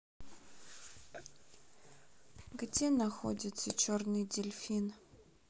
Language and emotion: Russian, sad